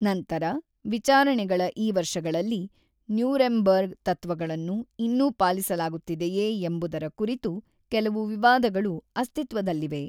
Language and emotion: Kannada, neutral